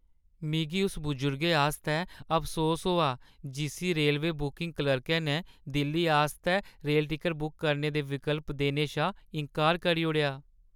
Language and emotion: Dogri, sad